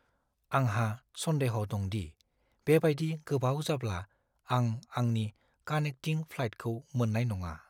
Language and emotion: Bodo, fearful